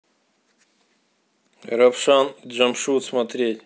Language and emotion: Russian, neutral